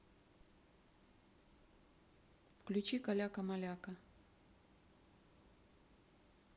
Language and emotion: Russian, neutral